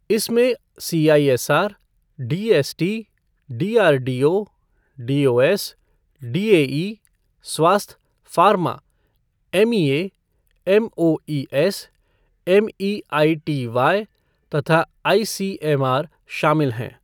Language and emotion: Hindi, neutral